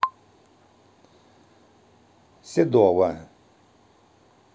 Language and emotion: Russian, neutral